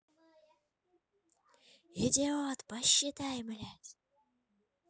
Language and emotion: Russian, angry